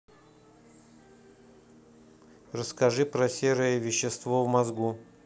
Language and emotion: Russian, neutral